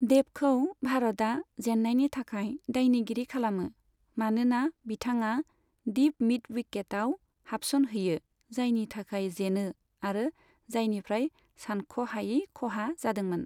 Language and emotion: Bodo, neutral